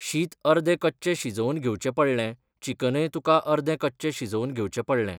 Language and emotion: Goan Konkani, neutral